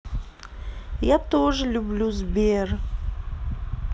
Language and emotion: Russian, sad